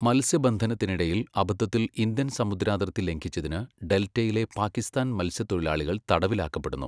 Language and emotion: Malayalam, neutral